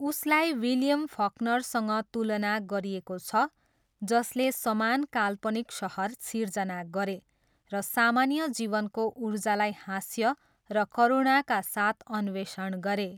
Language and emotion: Nepali, neutral